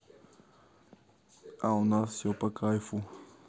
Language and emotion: Russian, neutral